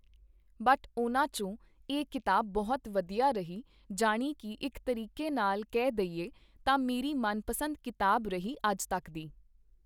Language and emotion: Punjabi, neutral